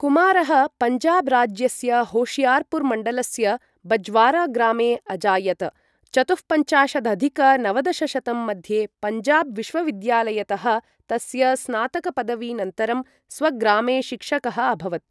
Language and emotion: Sanskrit, neutral